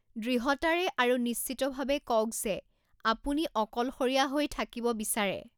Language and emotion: Assamese, neutral